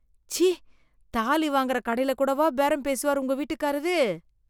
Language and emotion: Tamil, disgusted